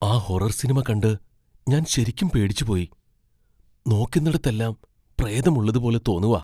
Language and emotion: Malayalam, fearful